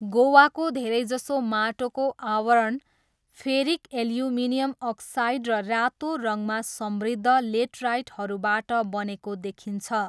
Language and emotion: Nepali, neutral